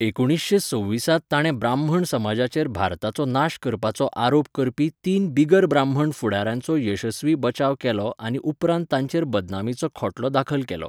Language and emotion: Goan Konkani, neutral